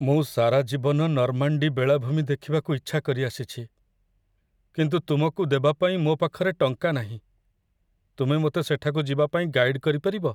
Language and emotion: Odia, sad